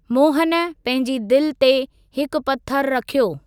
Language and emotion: Sindhi, neutral